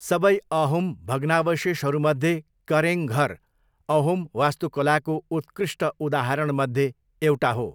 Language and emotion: Nepali, neutral